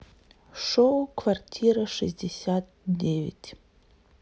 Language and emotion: Russian, neutral